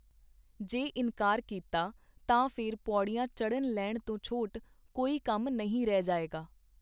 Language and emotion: Punjabi, neutral